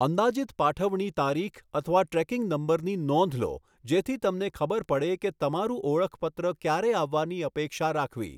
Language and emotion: Gujarati, neutral